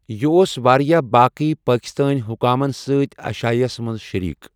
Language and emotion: Kashmiri, neutral